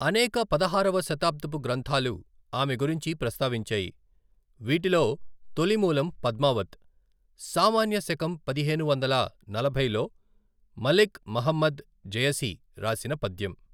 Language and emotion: Telugu, neutral